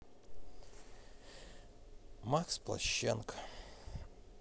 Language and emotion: Russian, sad